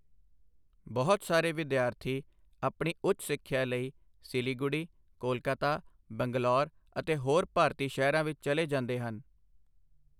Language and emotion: Punjabi, neutral